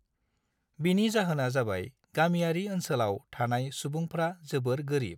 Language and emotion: Bodo, neutral